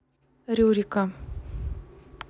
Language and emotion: Russian, neutral